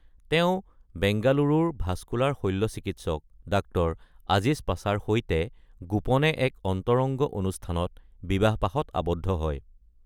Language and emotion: Assamese, neutral